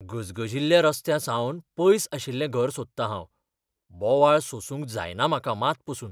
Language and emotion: Goan Konkani, fearful